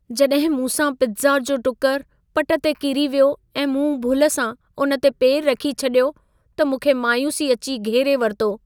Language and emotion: Sindhi, sad